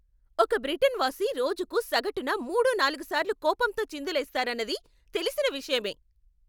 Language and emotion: Telugu, angry